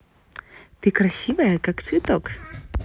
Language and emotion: Russian, positive